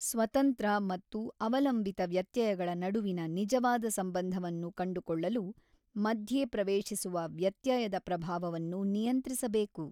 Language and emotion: Kannada, neutral